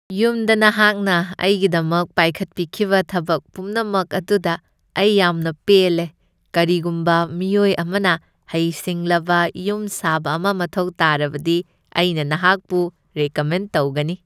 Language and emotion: Manipuri, happy